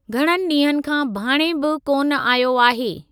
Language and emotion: Sindhi, neutral